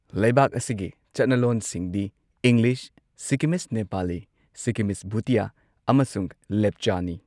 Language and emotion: Manipuri, neutral